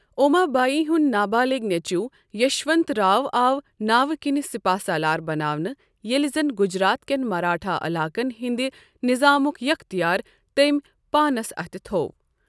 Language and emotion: Kashmiri, neutral